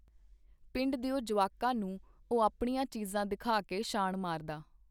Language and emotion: Punjabi, neutral